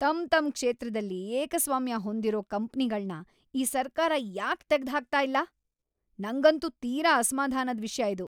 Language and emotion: Kannada, angry